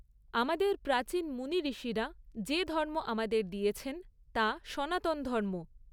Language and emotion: Bengali, neutral